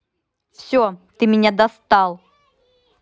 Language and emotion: Russian, angry